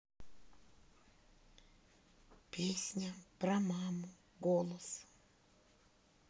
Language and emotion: Russian, sad